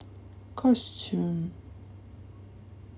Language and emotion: Russian, positive